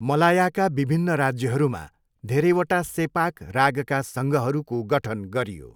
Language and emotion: Nepali, neutral